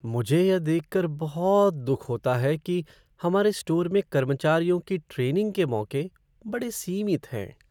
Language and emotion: Hindi, sad